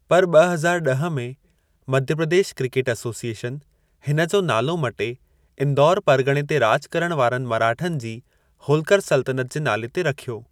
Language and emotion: Sindhi, neutral